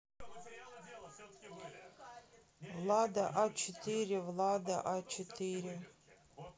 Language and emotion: Russian, neutral